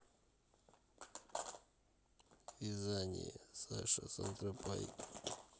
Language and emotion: Russian, neutral